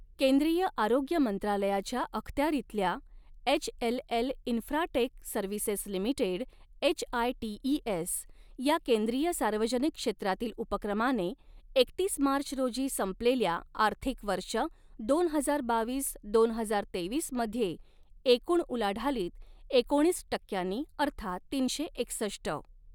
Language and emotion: Marathi, neutral